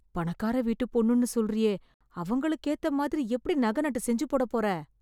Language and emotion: Tamil, fearful